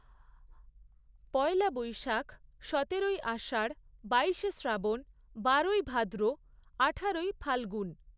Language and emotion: Bengali, neutral